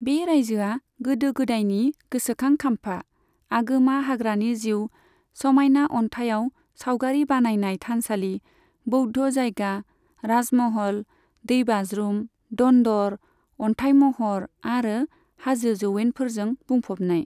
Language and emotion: Bodo, neutral